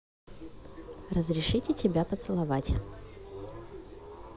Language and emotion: Russian, neutral